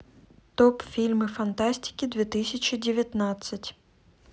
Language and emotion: Russian, neutral